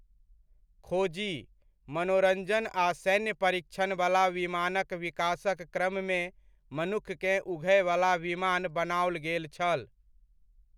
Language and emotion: Maithili, neutral